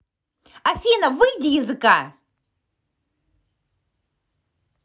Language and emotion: Russian, angry